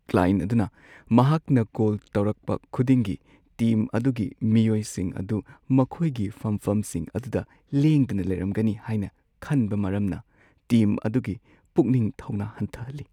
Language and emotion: Manipuri, sad